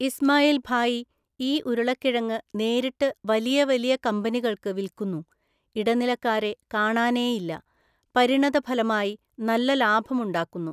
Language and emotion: Malayalam, neutral